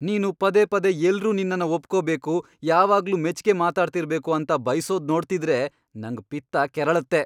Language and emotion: Kannada, angry